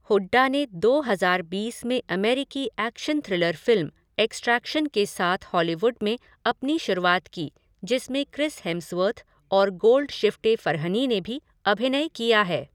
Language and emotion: Hindi, neutral